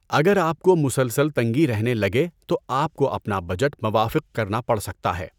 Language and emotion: Urdu, neutral